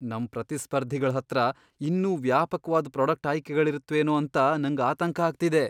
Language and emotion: Kannada, fearful